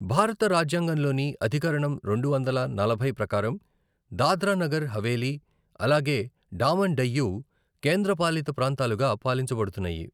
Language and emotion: Telugu, neutral